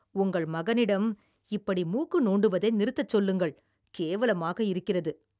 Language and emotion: Tamil, disgusted